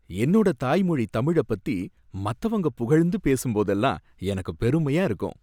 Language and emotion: Tamil, happy